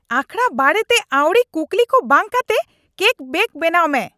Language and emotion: Santali, angry